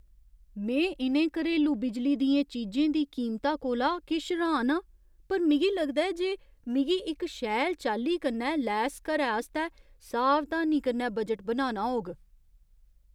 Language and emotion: Dogri, surprised